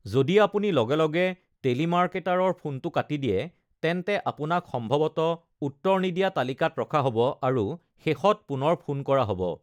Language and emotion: Assamese, neutral